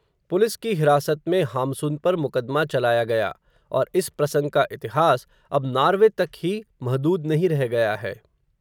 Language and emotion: Hindi, neutral